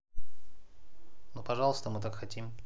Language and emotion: Russian, neutral